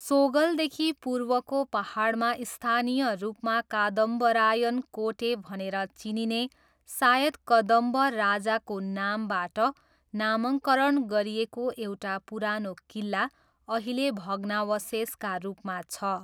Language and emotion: Nepali, neutral